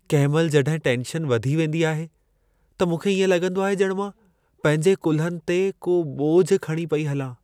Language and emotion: Sindhi, sad